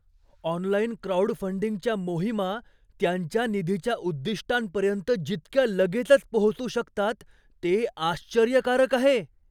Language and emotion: Marathi, surprised